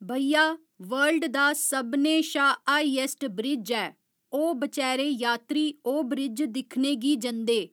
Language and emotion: Dogri, neutral